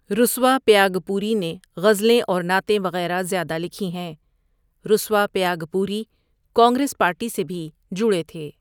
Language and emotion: Urdu, neutral